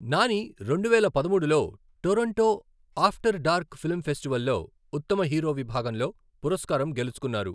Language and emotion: Telugu, neutral